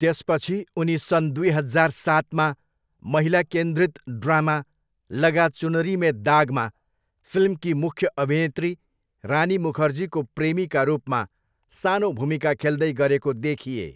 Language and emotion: Nepali, neutral